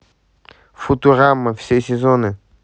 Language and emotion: Russian, neutral